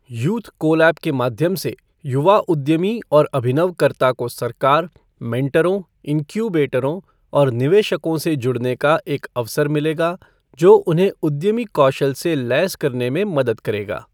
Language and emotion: Hindi, neutral